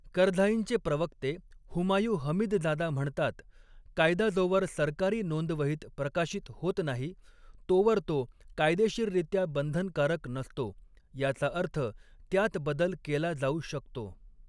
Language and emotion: Marathi, neutral